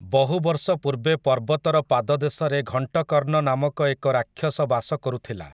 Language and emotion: Odia, neutral